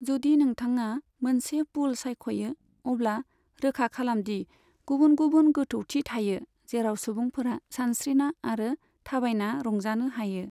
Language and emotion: Bodo, neutral